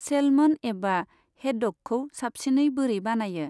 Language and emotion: Bodo, neutral